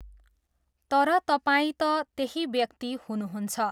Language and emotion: Nepali, neutral